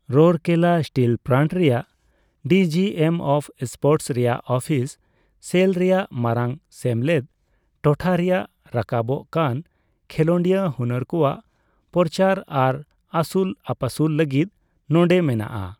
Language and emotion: Santali, neutral